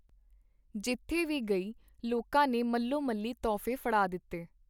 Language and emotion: Punjabi, neutral